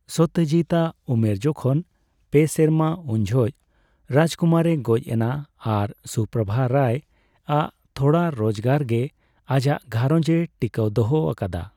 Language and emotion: Santali, neutral